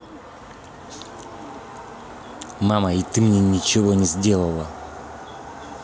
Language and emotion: Russian, angry